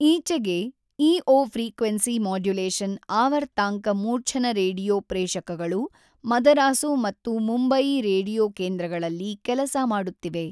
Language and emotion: Kannada, neutral